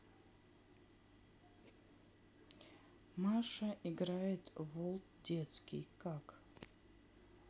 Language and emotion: Russian, neutral